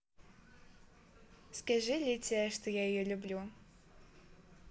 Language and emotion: Russian, positive